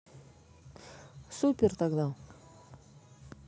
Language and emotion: Russian, neutral